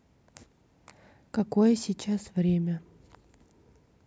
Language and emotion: Russian, neutral